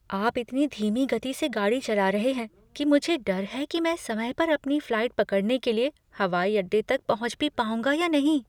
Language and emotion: Hindi, fearful